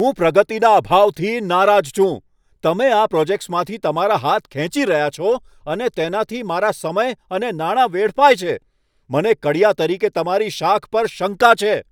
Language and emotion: Gujarati, angry